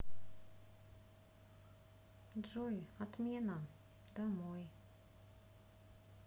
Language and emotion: Russian, neutral